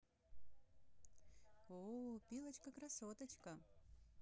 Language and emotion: Russian, positive